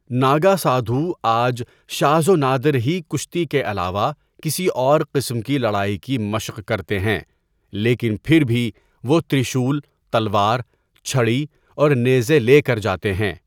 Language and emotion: Urdu, neutral